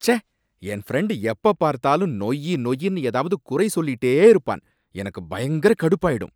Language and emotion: Tamil, angry